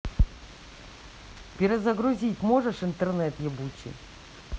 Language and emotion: Russian, angry